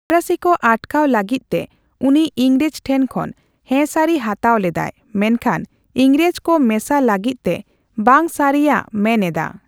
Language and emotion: Santali, neutral